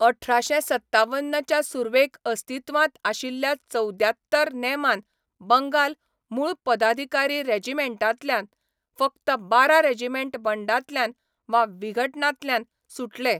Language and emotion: Goan Konkani, neutral